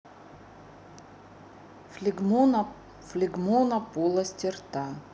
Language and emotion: Russian, neutral